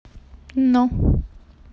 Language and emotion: Russian, neutral